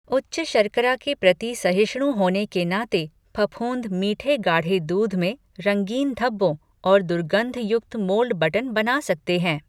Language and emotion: Hindi, neutral